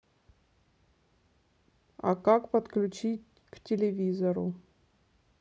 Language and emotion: Russian, neutral